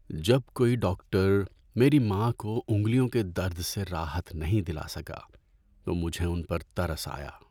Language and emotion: Urdu, sad